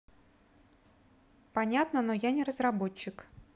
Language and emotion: Russian, neutral